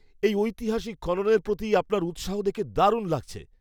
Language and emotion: Bengali, happy